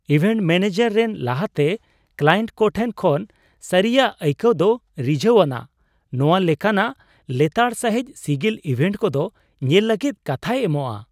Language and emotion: Santali, surprised